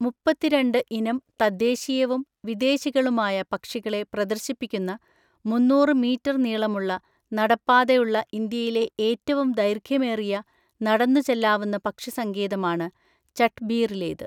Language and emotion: Malayalam, neutral